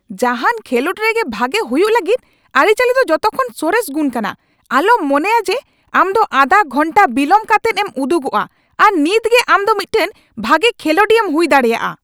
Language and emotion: Santali, angry